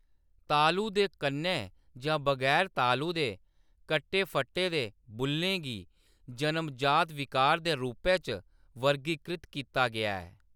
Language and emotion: Dogri, neutral